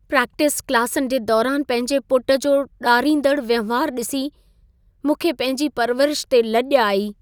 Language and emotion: Sindhi, sad